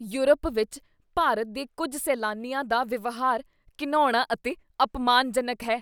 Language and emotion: Punjabi, disgusted